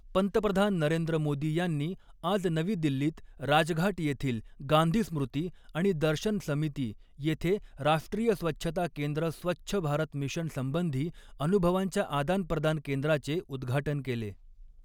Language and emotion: Marathi, neutral